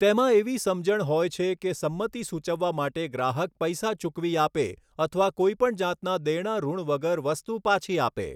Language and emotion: Gujarati, neutral